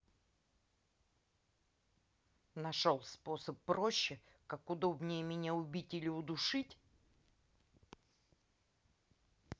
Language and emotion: Russian, angry